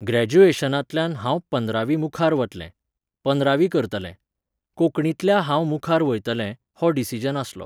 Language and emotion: Goan Konkani, neutral